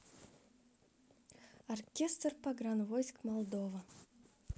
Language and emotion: Russian, neutral